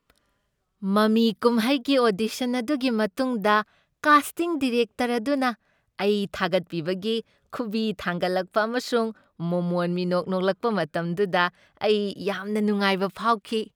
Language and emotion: Manipuri, happy